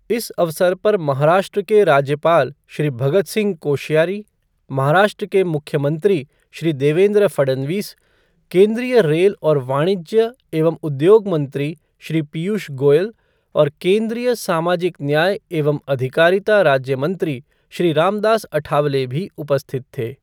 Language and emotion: Hindi, neutral